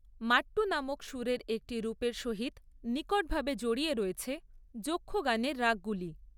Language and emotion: Bengali, neutral